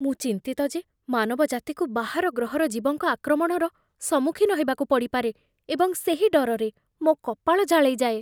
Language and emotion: Odia, fearful